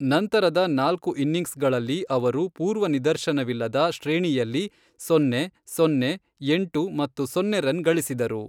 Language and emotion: Kannada, neutral